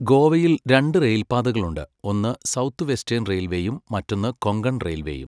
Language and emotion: Malayalam, neutral